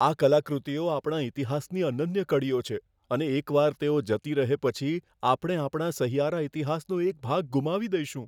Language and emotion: Gujarati, fearful